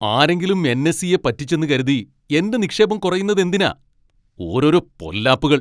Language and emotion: Malayalam, angry